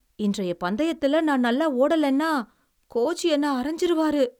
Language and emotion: Tamil, fearful